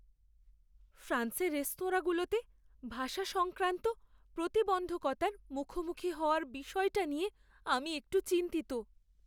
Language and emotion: Bengali, fearful